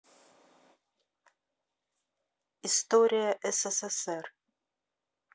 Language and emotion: Russian, neutral